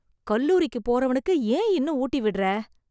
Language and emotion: Tamil, disgusted